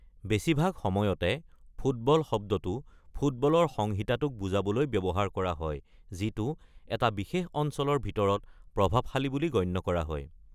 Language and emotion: Assamese, neutral